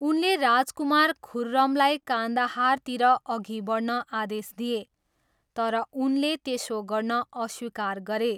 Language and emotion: Nepali, neutral